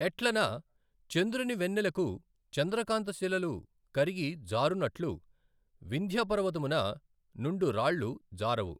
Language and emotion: Telugu, neutral